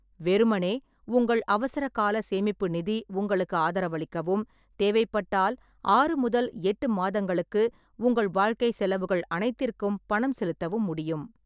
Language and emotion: Tamil, neutral